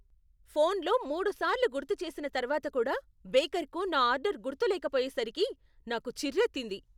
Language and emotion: Telugu, angry